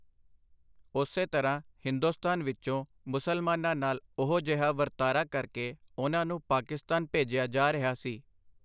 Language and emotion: Punjabi, neutral